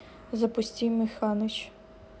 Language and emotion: Russian, neutral